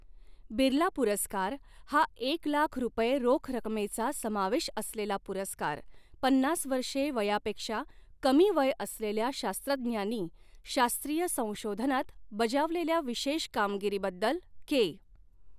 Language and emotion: Marathi, neutral